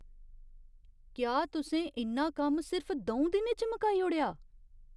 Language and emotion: Dogri, surprised